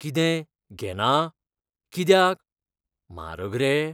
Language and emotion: Goan Konkani, fearful